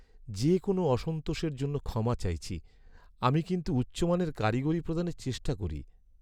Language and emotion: Bengali, sad